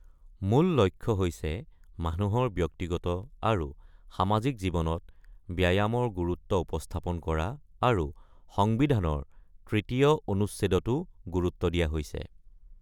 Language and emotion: Assamese, neutral